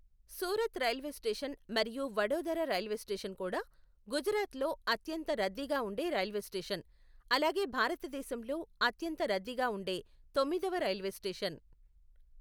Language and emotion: Telugu, neutral